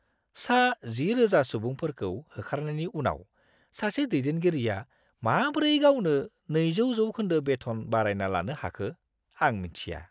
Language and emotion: Bodo, disgusted